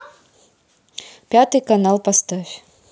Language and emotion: Russian, neutral